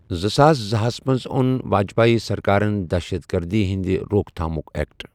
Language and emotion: Kashmiri, neutral